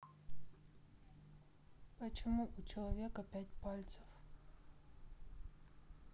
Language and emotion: Russian, neutral